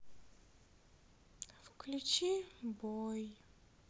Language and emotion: Russian, sad